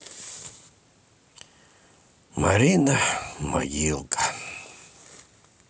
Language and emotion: Russian, sad